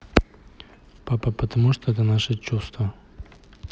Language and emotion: Russian, neutral